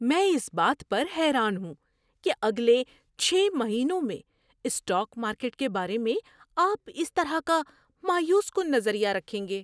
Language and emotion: Urdu, surprised